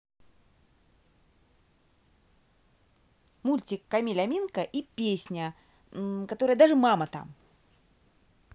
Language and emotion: Russian, positive